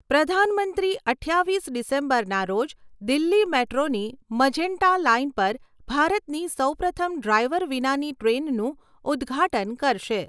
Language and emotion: Gujarati, neutral